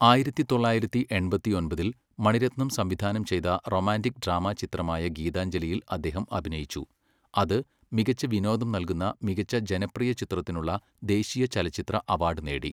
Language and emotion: Malayalam, neutral